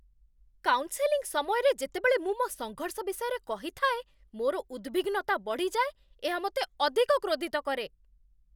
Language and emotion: Odia, angry